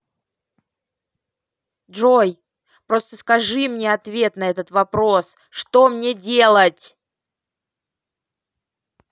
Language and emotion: Russian, angry